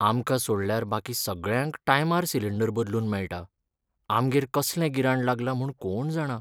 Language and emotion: Goan Konkani, sad